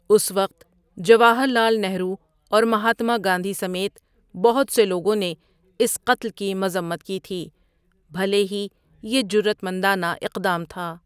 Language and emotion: Urdu, neutral